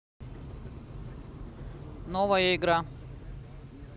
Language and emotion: Russian, neutral